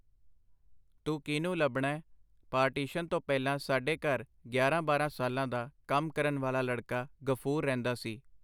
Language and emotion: Punjabi, neutral